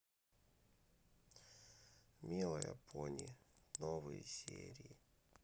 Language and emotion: Russian, neutral